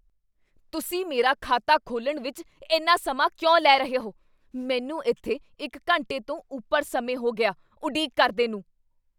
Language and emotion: Punjabi, angry